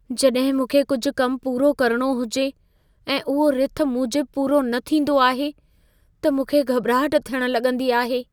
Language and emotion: Sindhi, fearful